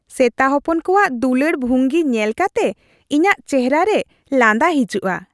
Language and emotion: Santali, happy